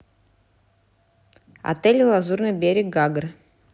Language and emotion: Russian, neutral